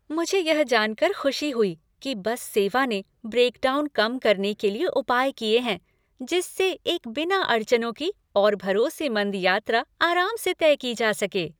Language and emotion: Hindi, happy